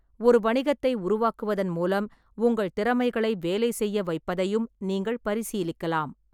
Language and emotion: Tamil, neutral